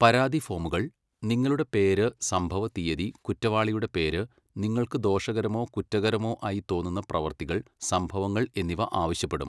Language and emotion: Malayalam, neutral